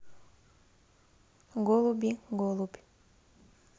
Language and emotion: Russian, neutral